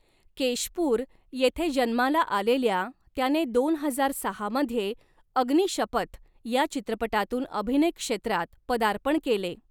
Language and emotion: Marathi, neutral